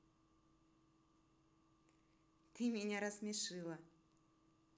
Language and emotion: Russian, positive